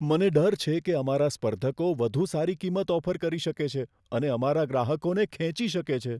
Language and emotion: Gujarati, fearful